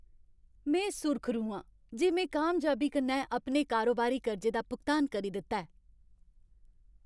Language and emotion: Dogri, happy